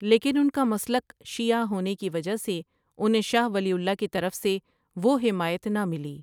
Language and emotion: Urdu, neutral